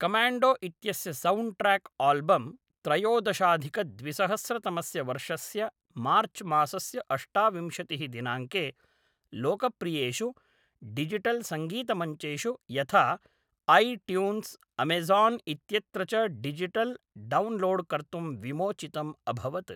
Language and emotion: Sanskrit, neutral